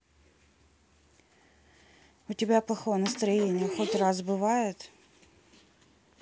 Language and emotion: Russian, sad